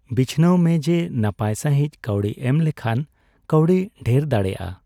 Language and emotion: Santali, neutral